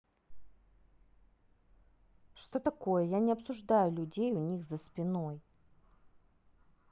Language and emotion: Russian, angry